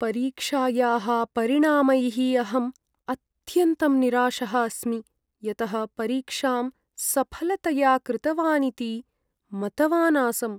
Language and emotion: Sanskrit, sad